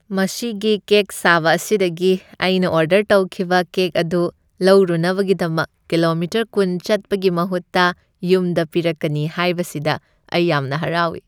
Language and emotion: Manipuri, happy